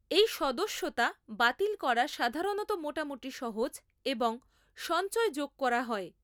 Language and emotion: Bengali, neutral